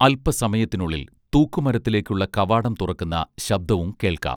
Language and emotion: Malayalam, neutral